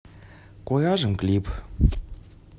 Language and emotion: Russian, neutral